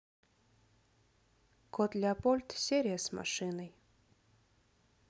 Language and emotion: Russian, sad